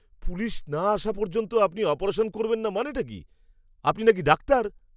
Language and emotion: Bengali, angry